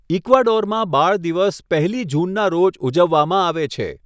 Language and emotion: Gujarati, neutral